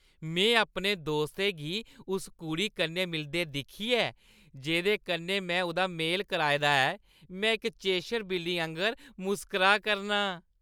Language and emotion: Dogri, happy